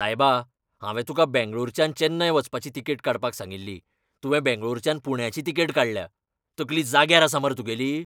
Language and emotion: Goan Konkani, angry